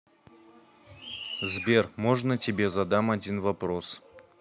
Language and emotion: Russian, neutral